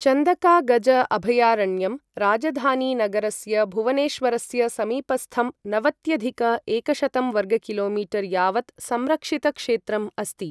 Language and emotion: Sanskrit, neutral